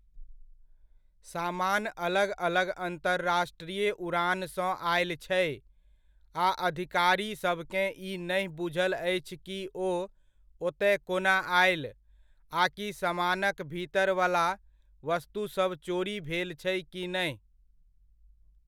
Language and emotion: Maithili, neutral